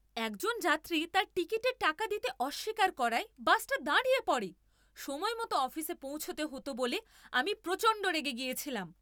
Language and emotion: Bengali, angry